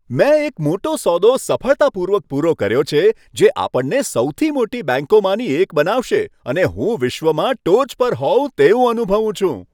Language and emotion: Gujarati, happy